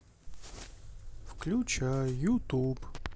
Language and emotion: Russian, sad